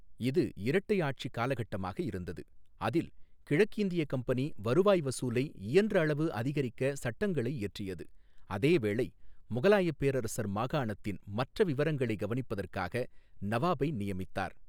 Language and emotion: Tamil, neutral